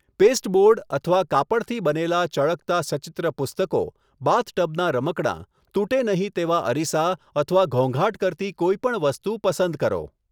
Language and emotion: Gujarati, neutral